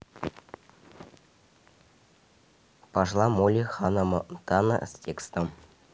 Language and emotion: Russian, neutral